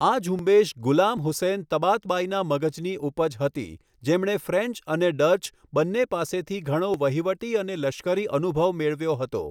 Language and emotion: Gujarati, neutral